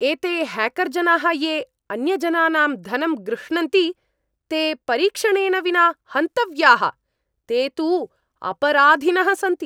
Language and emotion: Sanskrit, angry